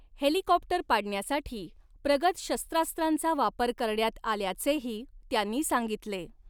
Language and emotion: Marathi, neutral